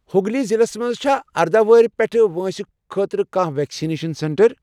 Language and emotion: Kashmiri, neutral